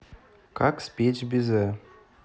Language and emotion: Russian, neutral